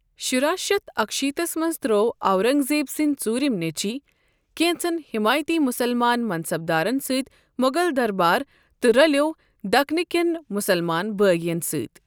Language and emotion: Kashmiri, neutral